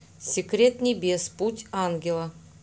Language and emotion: Russian, neutral